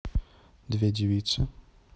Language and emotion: Russian, neutral